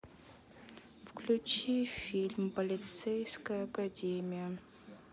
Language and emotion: Russian, sad